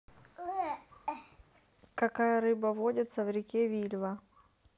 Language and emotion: Russian, neutral